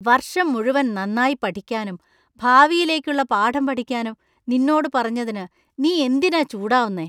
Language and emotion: Malayalam, disgusted